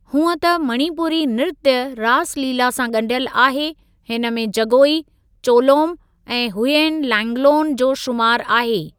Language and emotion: Sindhi, neutral